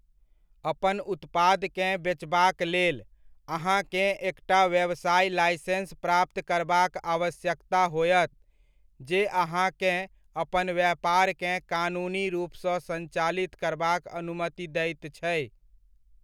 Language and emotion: Maithili, neutral